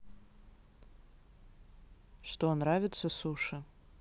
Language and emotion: Russian, neutral